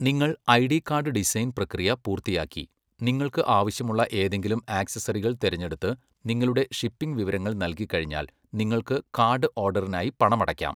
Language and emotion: Malayalam, neutral